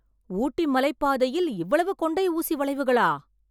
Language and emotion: Tamil, surprised